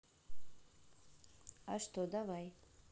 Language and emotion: Russian, neutral